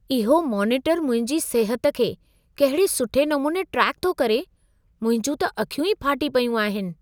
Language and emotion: Sindhi, surprised